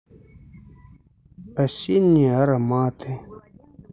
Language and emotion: Russian, neutral